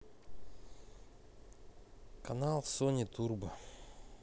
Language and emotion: Russian, neutral